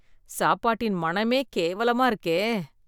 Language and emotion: Tamil, disgusted